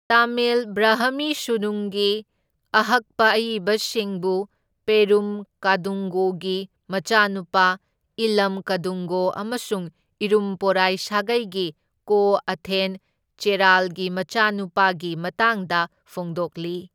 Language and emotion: Manipuri, neutral